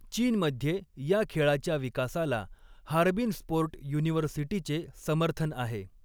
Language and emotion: Marathi, neutral